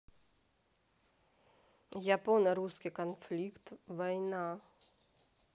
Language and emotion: Russian, neutral